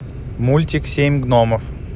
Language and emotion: Russian, neutral